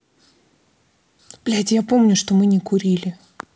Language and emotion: Russian, angry